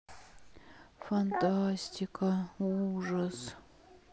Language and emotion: Russian, sad